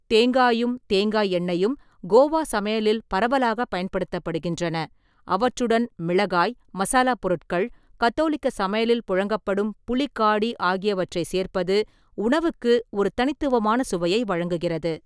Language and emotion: Tamil, neutral